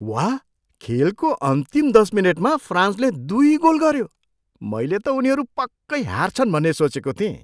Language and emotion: Nepali, surprised